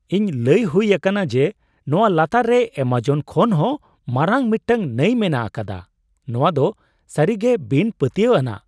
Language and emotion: Santali, surprised